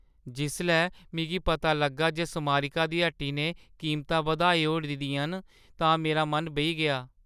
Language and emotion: Dogri, sad